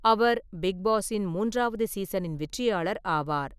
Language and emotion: Tamil, neutral